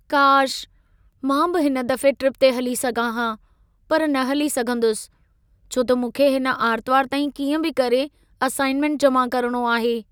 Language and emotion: Sindhi, sad